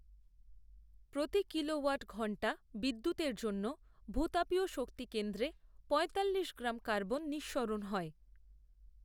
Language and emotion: Bengali, neutral